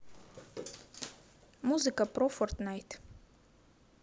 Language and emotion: Russian, neutral